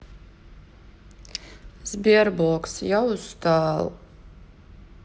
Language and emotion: Russian, sad